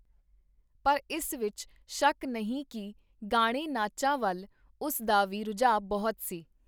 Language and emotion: Punjabi, neutral